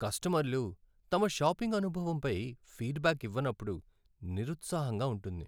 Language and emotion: Telugu, sad